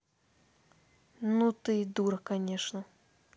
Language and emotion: Russian, angry